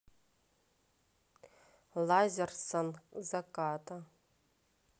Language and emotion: Russian, neutral